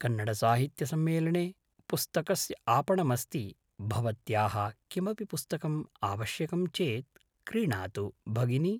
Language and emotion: Sanskrit, neutral